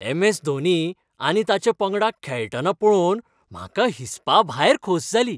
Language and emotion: Goan Konkani, happy